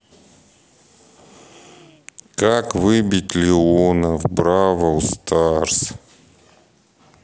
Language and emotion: Russian, sad